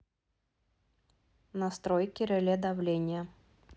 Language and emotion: Russian, neutral